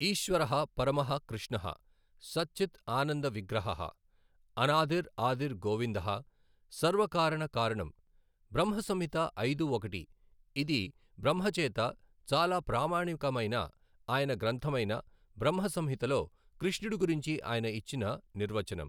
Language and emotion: Telugu, neutral